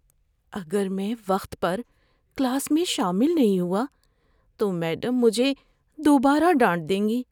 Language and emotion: Urdu, fearful